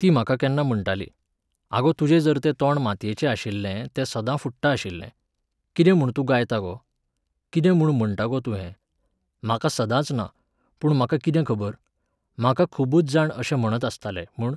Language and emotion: Goan Konkani, neutral